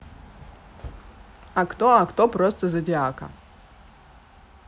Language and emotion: Russian, neutral